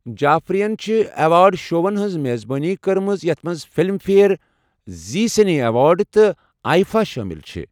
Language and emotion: Kashmiri, neutral